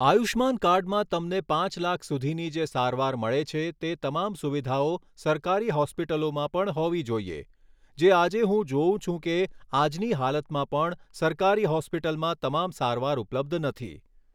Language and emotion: Gujarati, neutral